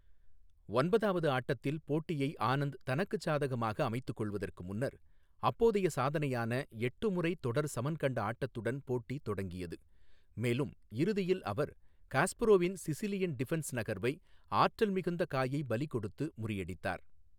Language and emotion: Tamil, neutral